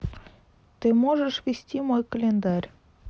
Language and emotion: Russian, neutral